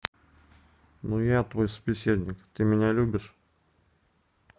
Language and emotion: Russian, neutral